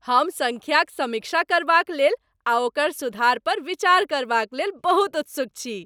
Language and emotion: Maithili, happy